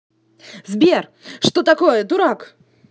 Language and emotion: Russian, angry